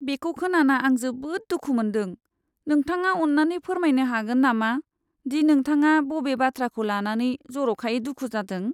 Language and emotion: Bodo, sad